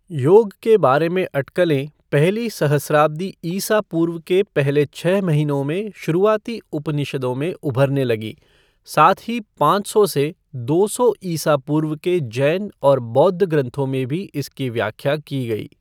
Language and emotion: Hindi, neutral